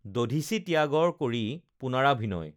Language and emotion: Assamese, neutral